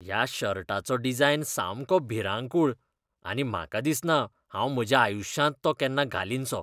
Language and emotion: Goan Konkani, disgusted